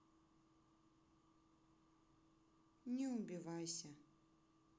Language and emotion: Russian, sad